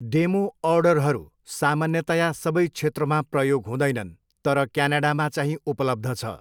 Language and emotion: Nepali, neutral